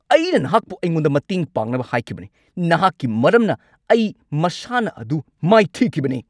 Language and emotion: Manipuri, angry